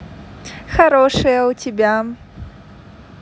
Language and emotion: Russian, positive